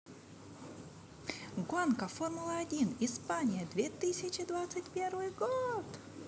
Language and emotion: Russian, positive